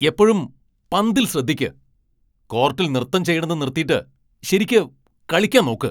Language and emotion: Malayalam, angry